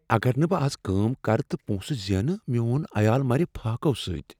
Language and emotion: Kashmiri, fearful